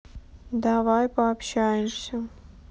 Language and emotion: Russian, sad